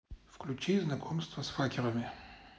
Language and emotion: Russian, neutral